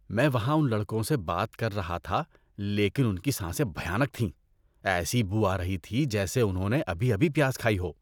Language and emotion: Urdu, disgusted